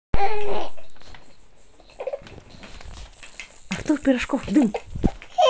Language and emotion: Russian, positive